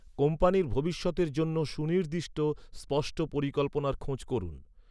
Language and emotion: Bengali, neutral